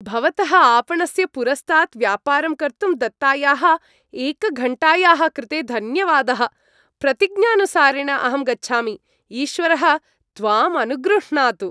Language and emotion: Sanskrit, happy